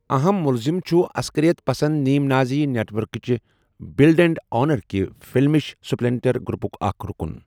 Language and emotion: Kashmiri, neutral